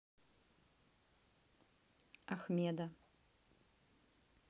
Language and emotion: Russian, neutral